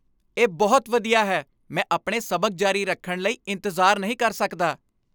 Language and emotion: Punjabi, happy